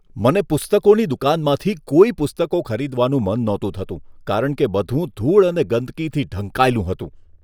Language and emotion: Gujarati, disgusted